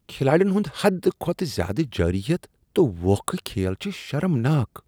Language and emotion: Kashmiri, disgusted